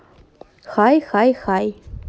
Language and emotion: Russian, neutral